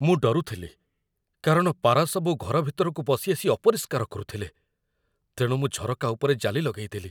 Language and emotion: Odia, fearful